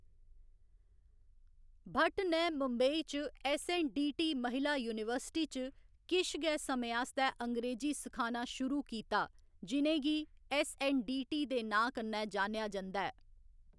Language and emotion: Dogri, neutral